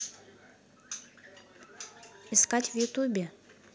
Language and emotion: Russian, neutral